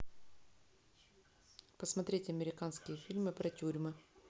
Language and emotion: Russian, neutral